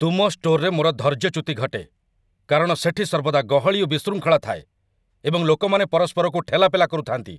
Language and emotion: Odia, angry